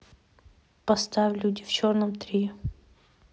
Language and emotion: Russian, neutral